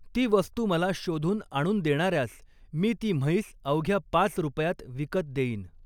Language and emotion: Marathi, neutral